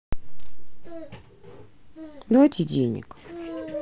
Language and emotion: Russian, sad